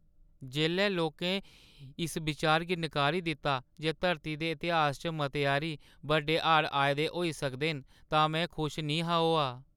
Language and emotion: Dogri, sad